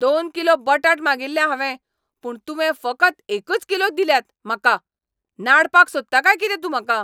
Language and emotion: Goan Konkani, angry